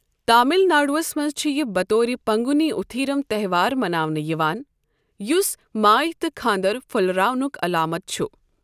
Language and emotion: Kashmiri, neutral